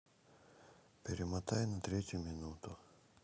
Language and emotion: Russian, sad